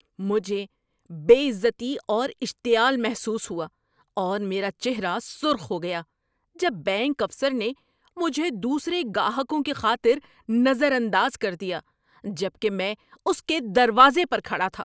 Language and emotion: Urdu, angry